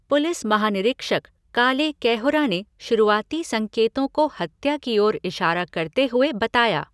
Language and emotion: Hindi, neutral